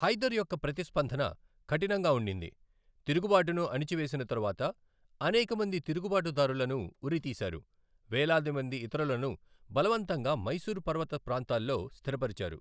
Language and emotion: Telugu, neutral